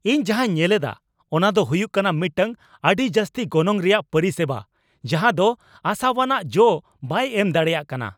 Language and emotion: Santali, angry